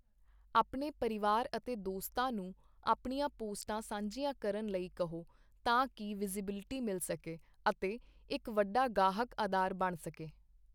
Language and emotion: Punjabi, neutral